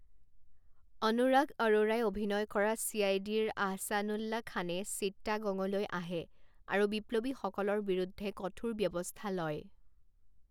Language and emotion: Assamese, neutral